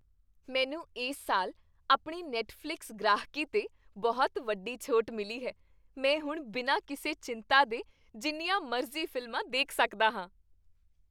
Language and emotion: Punjabi, happy